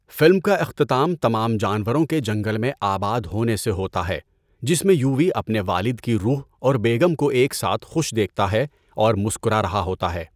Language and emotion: Urdu, neutral